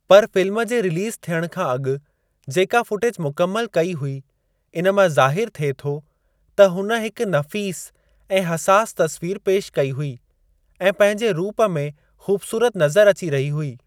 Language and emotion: Sindhi, neutral